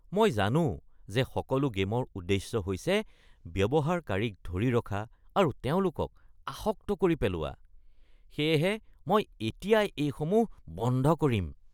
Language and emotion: Assamese, disgusted